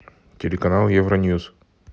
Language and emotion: Russian, neutral